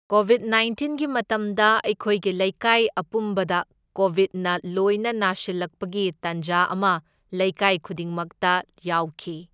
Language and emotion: Manipuri, neutral